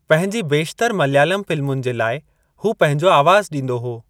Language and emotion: Sindhi, neutral